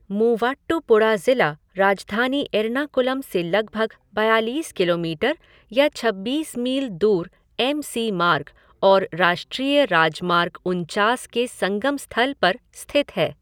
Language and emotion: Hindi, neutral